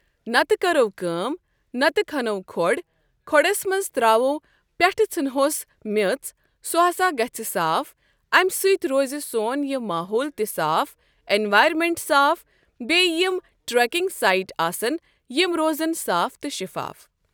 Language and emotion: Kashmiri, neutral